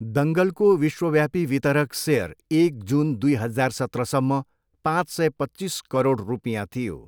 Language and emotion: Nepali, neutral